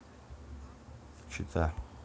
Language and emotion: Russian, neutral